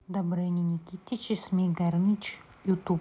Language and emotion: Russian, neutral